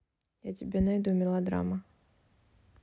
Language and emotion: Russian, neutral